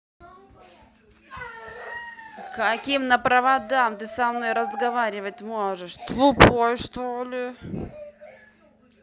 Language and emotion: Russian, angry